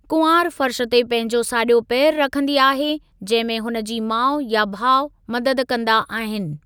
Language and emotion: Sindhi, neutral